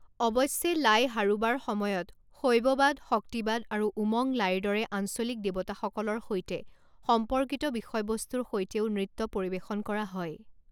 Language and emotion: Assamese, neutral